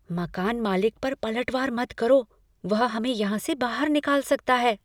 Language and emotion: Hindi, fearful